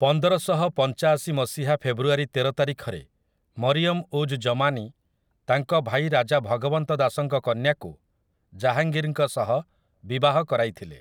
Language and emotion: Odia, neutral